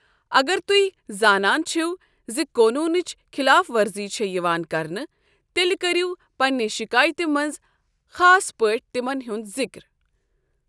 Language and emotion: Kashmiri, neutral